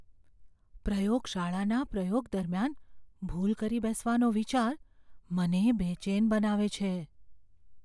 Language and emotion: Gujarati, fearful